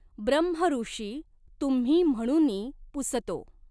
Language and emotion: Marathi, neutral